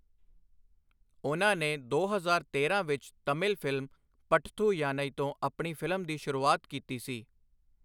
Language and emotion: Punjabi, neutral